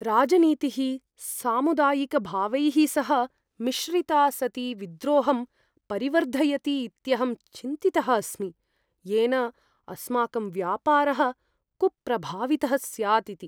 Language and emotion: Sanskrit, fearful